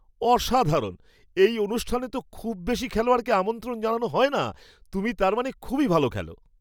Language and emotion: Bengali, surprised